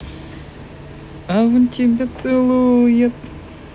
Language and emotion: Russian, positive